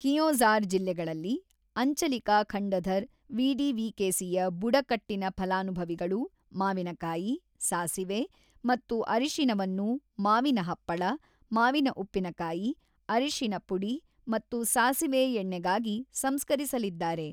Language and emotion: Kannada, neutral